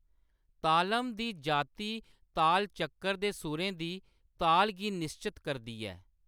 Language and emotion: Dogri, neutral